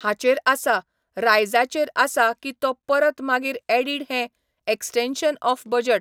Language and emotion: Goan Konkani, neutral